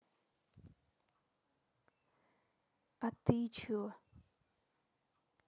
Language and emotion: Russian, neutral